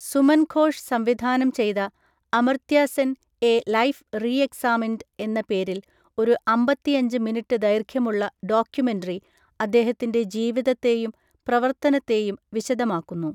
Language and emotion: Malayalam, neutral